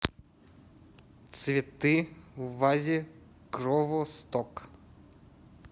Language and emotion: Russian, neutral